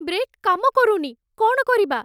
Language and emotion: Odia, fearful